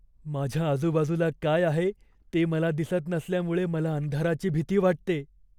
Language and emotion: Marathi, fearful